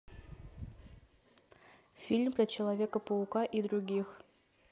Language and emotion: Russian, neutral